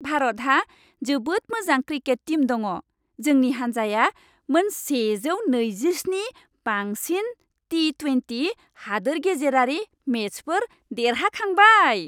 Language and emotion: Bodo, happy